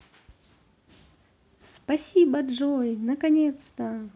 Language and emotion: Russian, positive